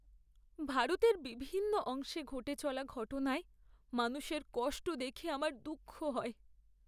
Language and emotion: Bengali, sad